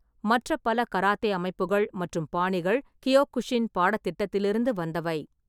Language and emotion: Tamil, neutral